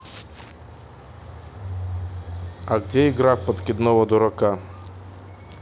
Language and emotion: Russian, neutral